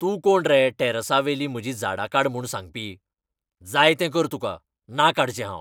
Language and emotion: Goan Konkani, angry